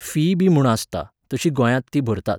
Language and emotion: Goan Konkani, neutral